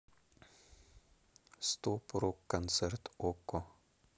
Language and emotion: Russian, neutral